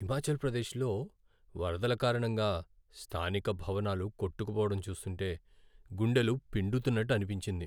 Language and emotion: Telugu, sad